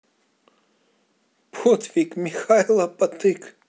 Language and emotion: Russian, positive